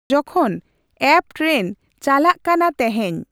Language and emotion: Santali, neutral